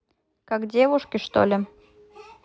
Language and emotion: Russian, neutral